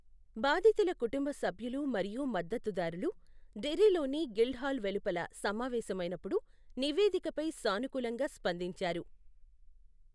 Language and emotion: Telugu, neutral